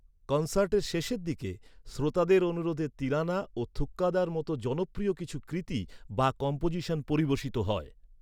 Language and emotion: Bengali, neutral